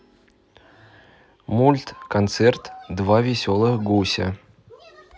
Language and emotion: Russian, neutral